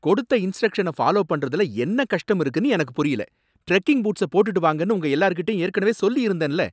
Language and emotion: Tamil, angry